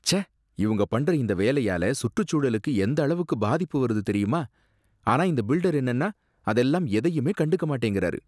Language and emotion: Tamil, disgusted